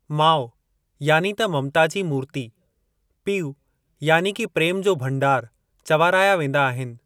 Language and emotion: Sindhi, neutral